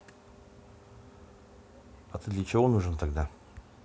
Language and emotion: Russian, neutral